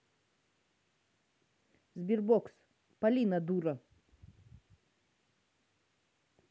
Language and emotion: Russian, angry